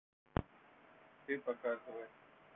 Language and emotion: Russian, neutral